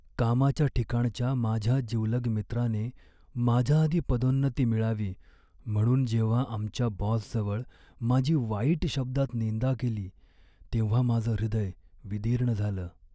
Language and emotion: Marathi, sad